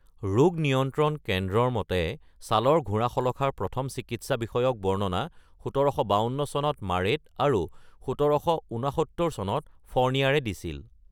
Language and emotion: Assamese, neutral